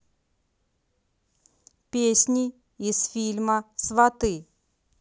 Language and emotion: Russian, neutral